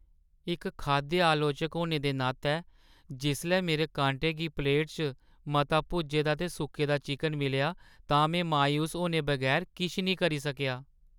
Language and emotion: Dogri, sad